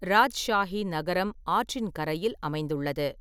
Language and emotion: Tamil, neutral